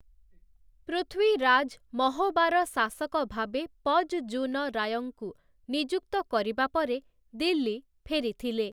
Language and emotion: Odia, neutral